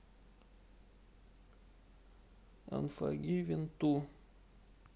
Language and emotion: Russian, sad